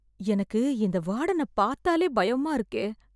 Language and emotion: Tamil, fearful